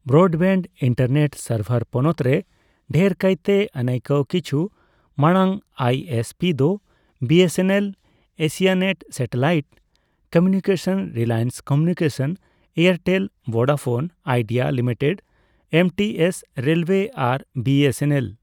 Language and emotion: Santali, neutral